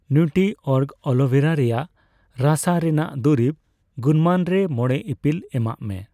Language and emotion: Santali, neutral